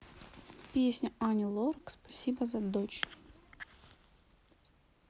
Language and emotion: Russian, neutral